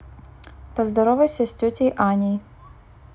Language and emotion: Russian, neutral